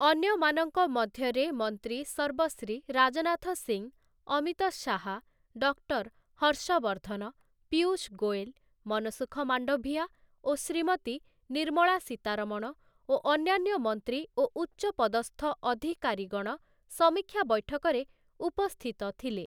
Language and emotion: Odia, neutral